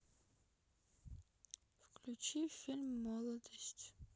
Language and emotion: Russian, sad